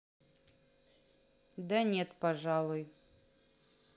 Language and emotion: Russian, neutral